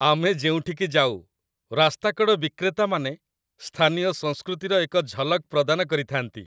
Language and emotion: Odia, happy